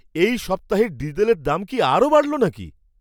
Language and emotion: Bengali, surprised